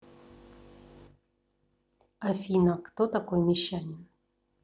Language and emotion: Russian, neutral